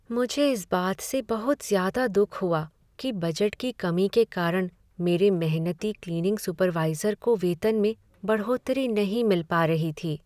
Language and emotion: Hindi, sad